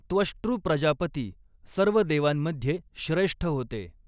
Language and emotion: Marathi, neutral